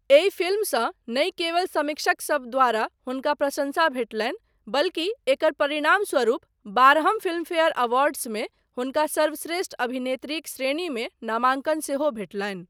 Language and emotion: Maithili, neutral